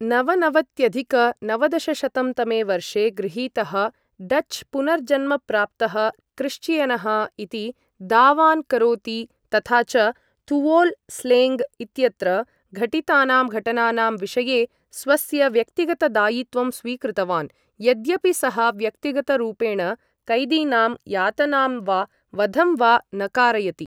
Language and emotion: Sanskrit, neutral